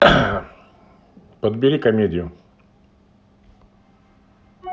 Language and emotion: Russian, neutral